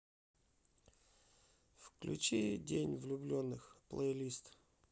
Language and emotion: Russian, neutral